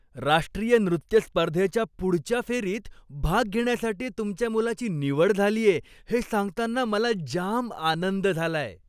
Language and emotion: Marathi, happy